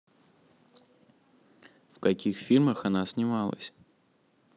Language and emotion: Russian, neutral